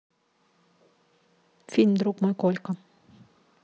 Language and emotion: Russian, neutral